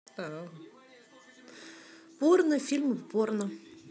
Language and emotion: Russian, neutral